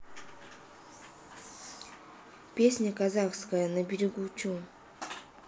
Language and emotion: Russian, neutral